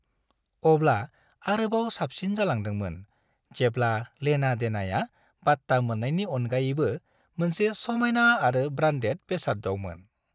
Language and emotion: Bodo, happy